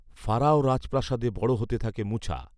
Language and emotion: Bengali, neutral